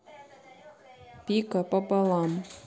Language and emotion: Russian, neutral